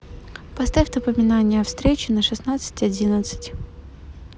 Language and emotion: Russian, neutral